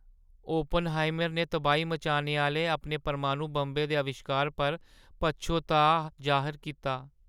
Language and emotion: Dogri, sad